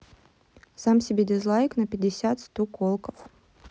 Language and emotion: Russian, neutral